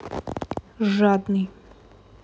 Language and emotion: Russian, angry